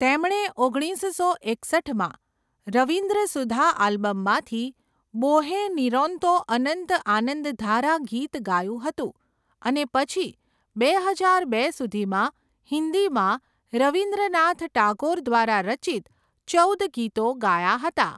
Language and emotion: Gujarati, neutral